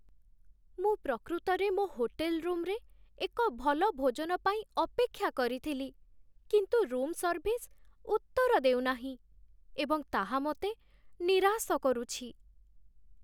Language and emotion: Odia, sad